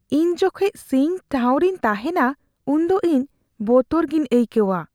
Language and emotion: Santali, fearful